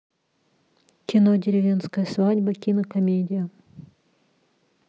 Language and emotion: Russian, neutral